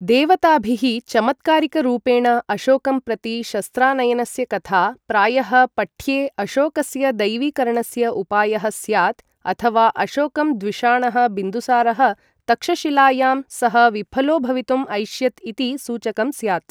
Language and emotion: Sanskrit, neutral